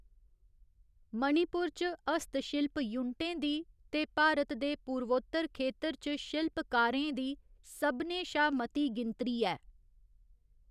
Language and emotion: Dogri, neutral